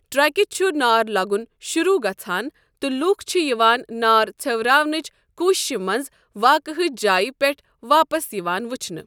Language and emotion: Kashmiri, neutral